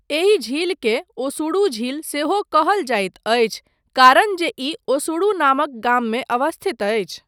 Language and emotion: Maithili, neutral